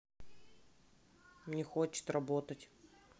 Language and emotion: Russian, sad